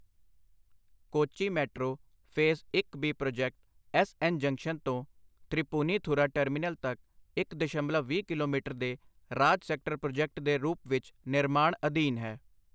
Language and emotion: Punjabi, neutral